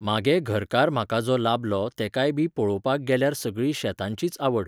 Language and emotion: Goan Konkani, neutral